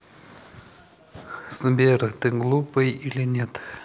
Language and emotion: Russian, neutral